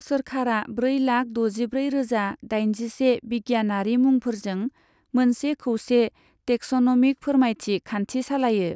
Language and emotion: Bodo, neutral